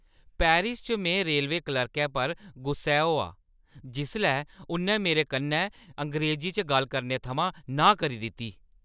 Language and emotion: Dogri, angry